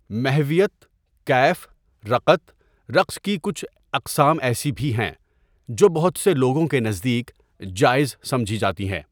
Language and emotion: Urdu, neutral